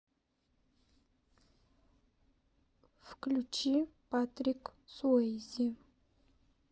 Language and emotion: Russian, neutral